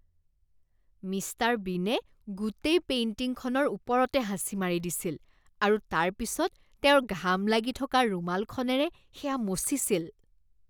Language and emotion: Assamese, disgusted